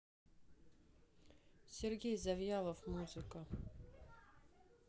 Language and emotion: Russian, neutral